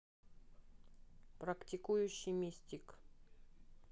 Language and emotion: Russian, neutral